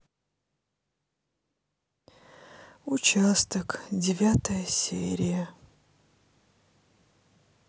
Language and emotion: Russian, sad